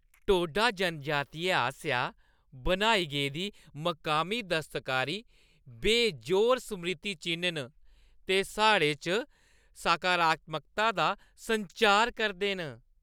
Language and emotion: Dogri, happy